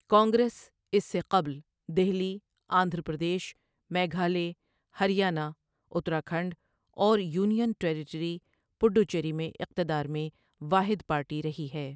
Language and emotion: Urdu, neutral